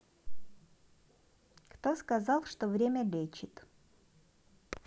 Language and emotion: Russian, neutral